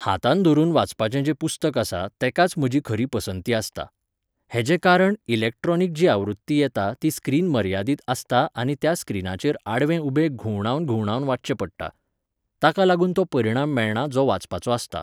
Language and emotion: Goan Konkani, neutral